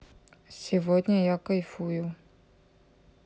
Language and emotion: Russian, neutral